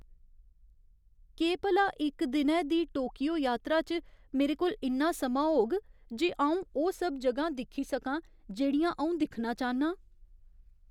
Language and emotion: Dogri, fearful